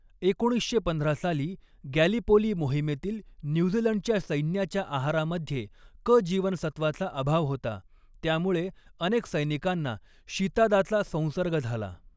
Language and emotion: Marathi, neutral